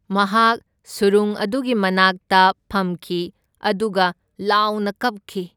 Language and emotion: Manipuri, neutral